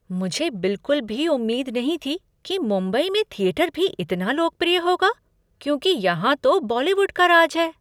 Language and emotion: Hindi, surprised